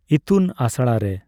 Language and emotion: Santali, neutral